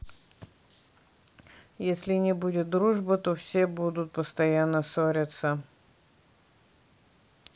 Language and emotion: Russian, neutral